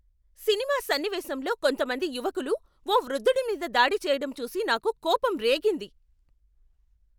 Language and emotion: Telugu, angry